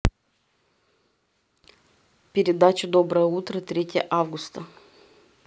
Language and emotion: Russian, neutral